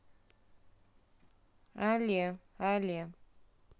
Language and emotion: Russian, neutral